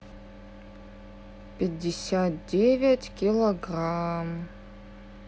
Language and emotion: Russian, neutral